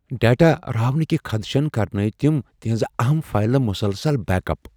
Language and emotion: Kashmiri, fearful